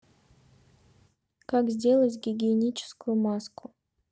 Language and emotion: Russian, neutral